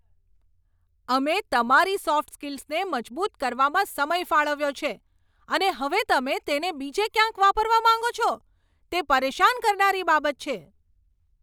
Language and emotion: Gujarati, angry